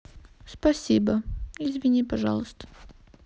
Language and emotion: Russian, sad